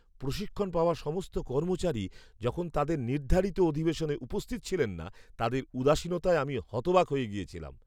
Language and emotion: Bengali, surprised